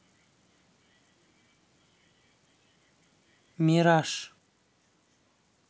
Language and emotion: Russian, neutral